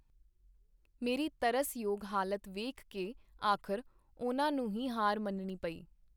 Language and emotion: Punjabi, neutral